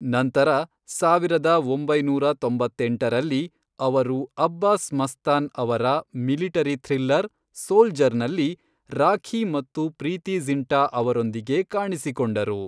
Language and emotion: Kannada, neutral